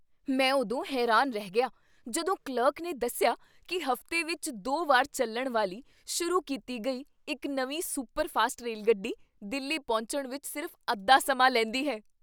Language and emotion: Punjabi, surprised